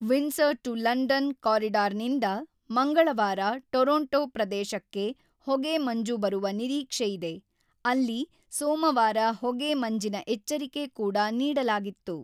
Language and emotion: Kannada, neutral